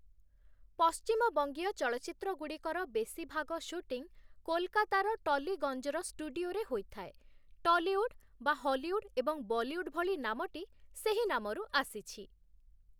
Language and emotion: Odia, neutral